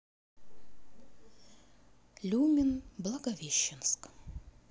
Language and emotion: Russian, sad